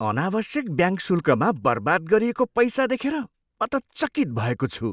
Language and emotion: Nepali, surprised